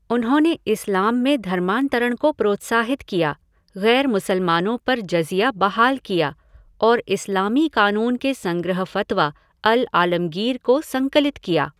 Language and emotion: Hindi, neutral